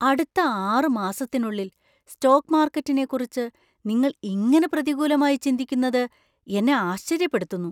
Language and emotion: Malayalam, surprised